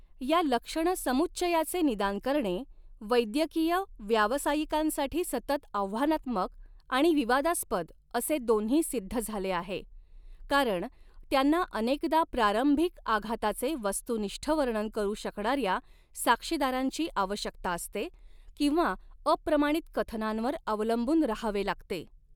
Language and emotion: Marathi, neutral